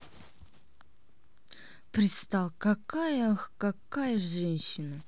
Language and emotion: Russian, neutral